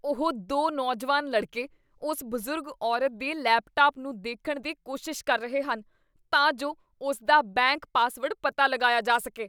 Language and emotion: Punjabi, disgusted